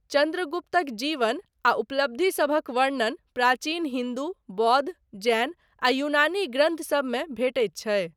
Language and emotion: Maithili, neutral